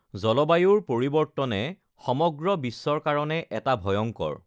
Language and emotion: Assamese, neutral